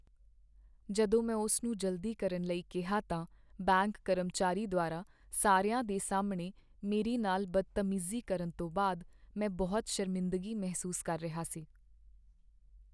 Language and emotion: Punjabi, sad